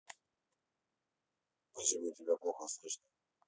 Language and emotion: Russian, neutral